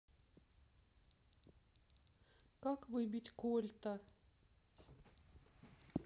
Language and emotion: Russian, sad